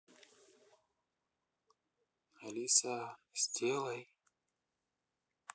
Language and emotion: Russian, neutral